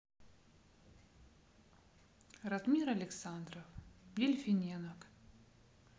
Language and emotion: Russian, neutral